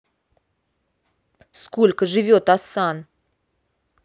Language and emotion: Russian, angry